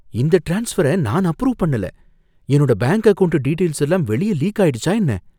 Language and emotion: Tamil, fearful